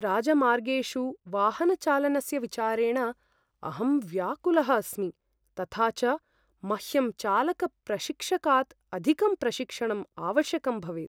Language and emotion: Sanskrit, fearful